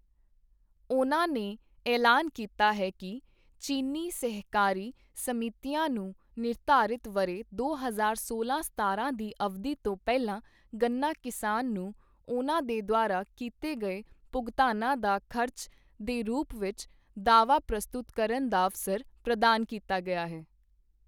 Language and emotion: Punjabi, neutral